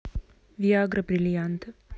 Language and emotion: Russian, neutral